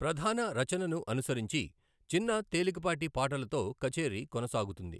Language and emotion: Telugu, neutral